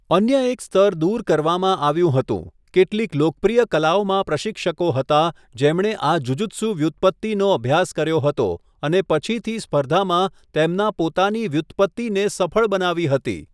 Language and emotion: Gujarati, neutral